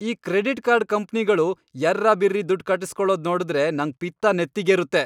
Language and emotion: Kannada, angry